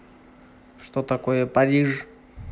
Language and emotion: Russian, neutral